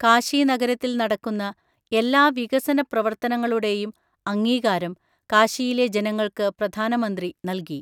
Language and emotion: Malayalam, neutral